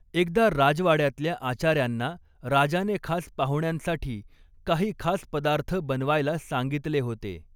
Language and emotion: Marathi, neutral